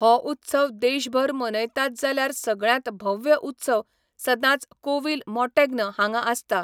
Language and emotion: Goan Konkani, neutral